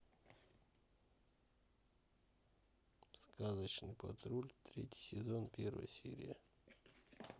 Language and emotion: Russian, neutral